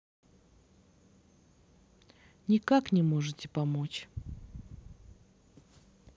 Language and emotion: Russian, sad